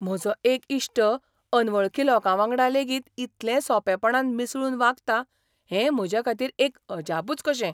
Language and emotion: Goan Konkani, surprised